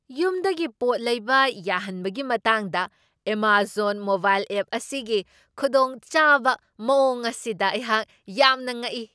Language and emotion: Manipuri, surprised